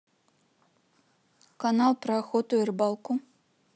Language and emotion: Russian, neutral